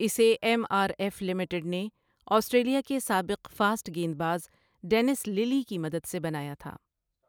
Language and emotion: Urdu, neutral